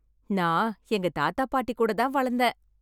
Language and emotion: Tamil, happy